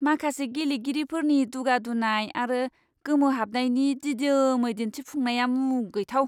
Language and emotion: Bodo, disgusted